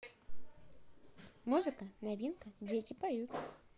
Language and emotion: Russian, positive